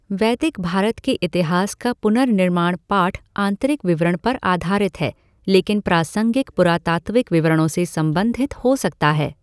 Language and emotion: Hindi, neutral